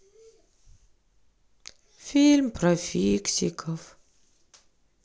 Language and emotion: Russian, sad